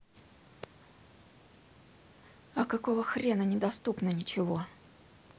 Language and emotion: Russian, angry